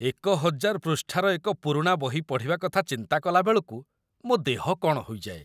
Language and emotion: Odia, disgusted